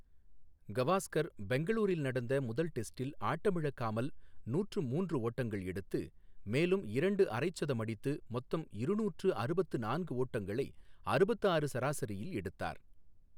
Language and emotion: Tamil, neutral